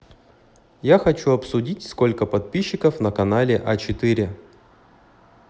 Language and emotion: Russian, neutral